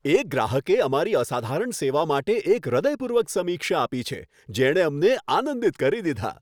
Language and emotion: Gujarati, happy